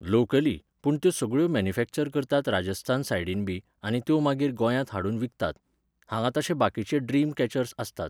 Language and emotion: Goan Konkani, neutral